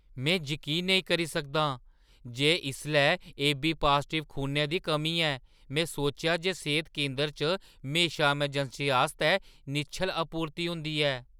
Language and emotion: Dogri, surprised